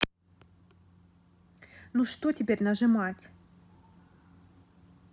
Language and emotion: Russian, angry